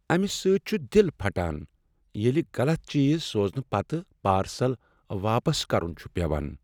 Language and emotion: Kashmiri, sad